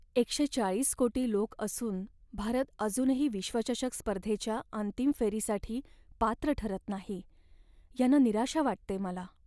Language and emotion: Marathi, sad